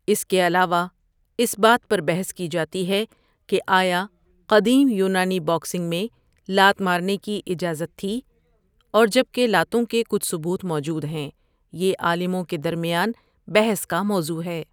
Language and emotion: Urdu, neutral